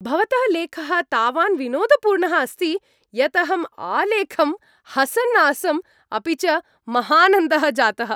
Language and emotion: Sanskrit, happy